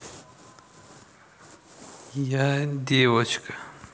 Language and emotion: Russian, neutral